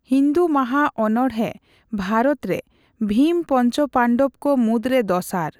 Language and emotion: Santali, neutral